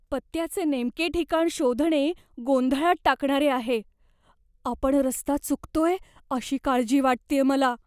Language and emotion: Marathi, fearful